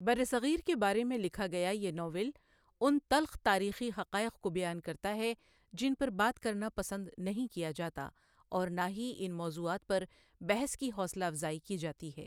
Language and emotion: Urdu, neutral